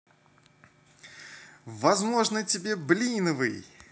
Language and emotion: Russian, positive